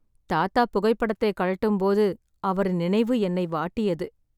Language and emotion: Tamil, sad